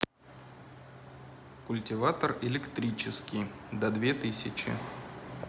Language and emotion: Russian, neutral